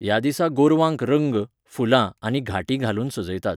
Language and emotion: Goan Konkani, neutral